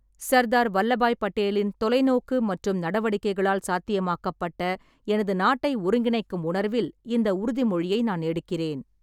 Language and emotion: Tamil, neutral